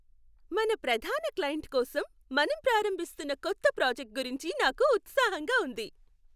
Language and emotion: Telugu, happy